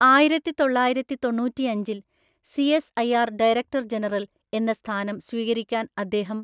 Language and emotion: Malayalam, neutral